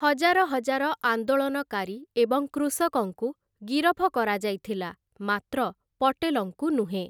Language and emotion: Odia, neutral